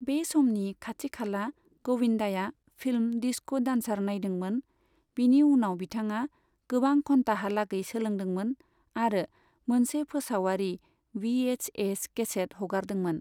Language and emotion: Bodo, neutral